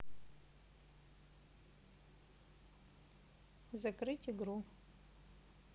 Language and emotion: Russian, neutral